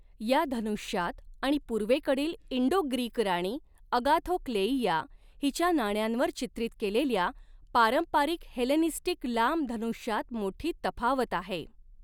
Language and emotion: Marathi, neutral